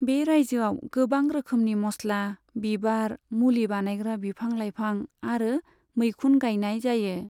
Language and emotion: Bodo, neutral